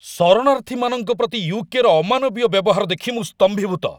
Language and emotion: Odia, angry